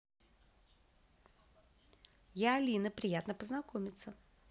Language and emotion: Russian, positive